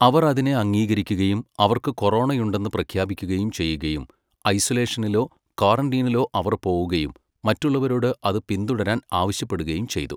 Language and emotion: Malayalam, neutral